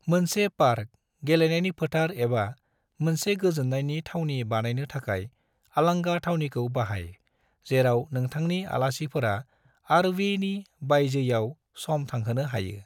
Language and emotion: Bodo, neutral